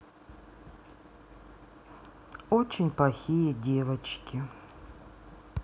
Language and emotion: Russian, sad